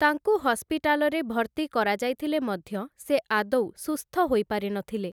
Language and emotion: Odia, neutral